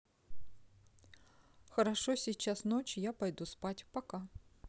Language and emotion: Russian, neutral